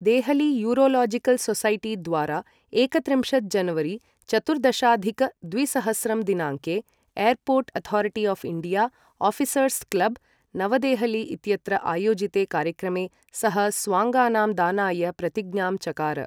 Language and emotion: Sanskrit, neutral